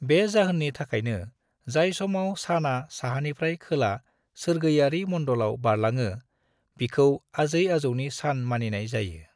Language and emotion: Bodo, neutral